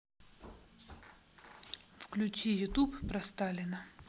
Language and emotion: Russian, neutral